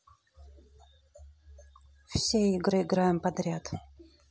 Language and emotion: Russian, neutral